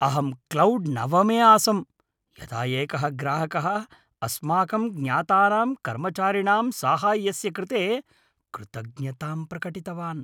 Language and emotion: Sanskrit, happy